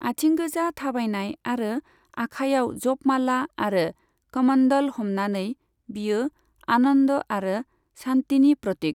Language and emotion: Bodo, neutral